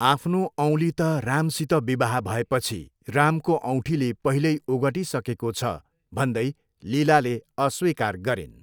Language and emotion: Nepali, neutral